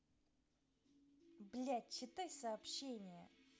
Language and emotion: Russian, angry